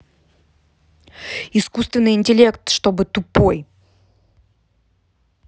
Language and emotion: Russian, angry